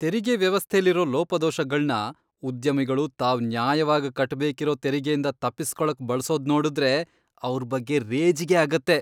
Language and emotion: Kannada, disgusted